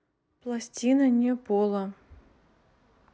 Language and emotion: Russian, neutral